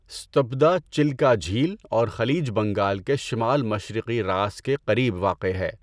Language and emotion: Urdu, neutral